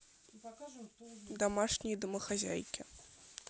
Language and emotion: Russian, neutral